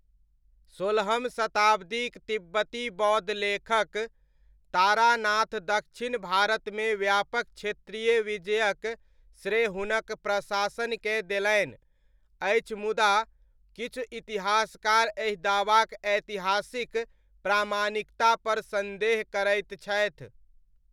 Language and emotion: Maithili, neutral